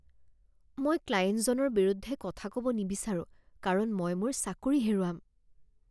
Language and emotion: Assamese, fearful